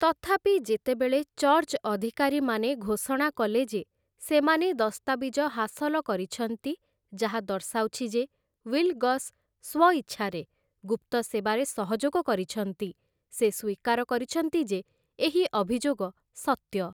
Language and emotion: Odia, neutral